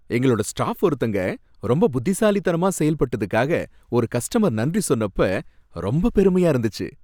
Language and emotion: Tamil, happy